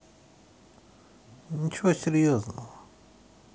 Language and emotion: Russian, neutral